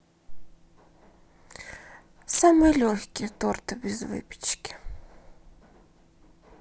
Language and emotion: Russian, sad